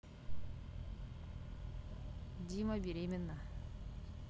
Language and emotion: Russian, neutral